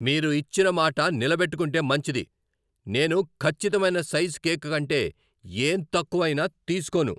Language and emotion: Telugu, angry